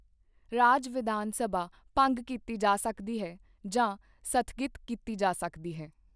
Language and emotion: Punjabi, neutral